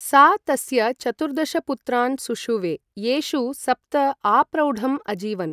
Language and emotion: Sanskrit, neutral